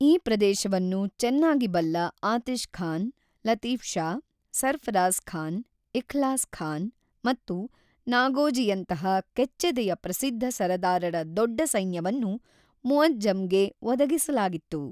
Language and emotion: Kannada, neutral